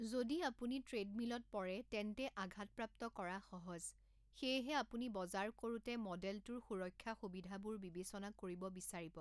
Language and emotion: Assamese, neutral